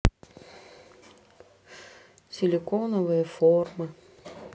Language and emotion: Russian, sad